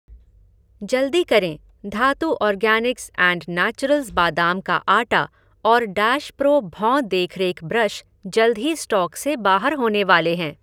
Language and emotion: Hindi, neutral